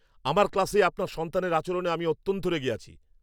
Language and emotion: Bengali, angry